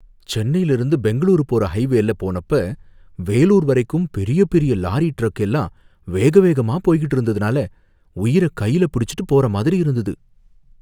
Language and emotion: Tamil, fearful